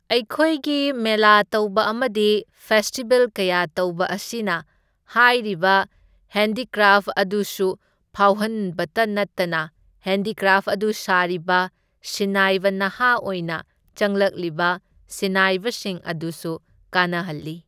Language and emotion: Manipuri, neutral